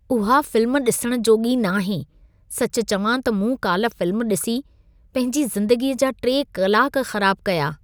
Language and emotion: Sindhi, disgusted